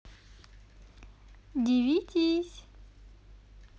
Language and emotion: Russian, positive